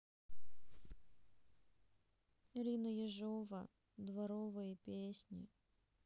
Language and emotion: Russian, sad